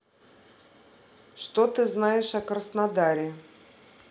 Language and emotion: Russian, neutral